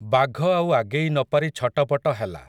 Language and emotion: Odia, neutral